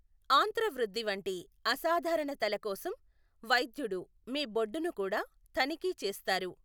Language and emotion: Telugu, neutral